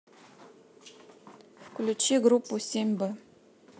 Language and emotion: Russian, neutral